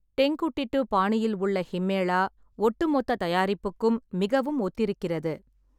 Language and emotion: Tamil, neutral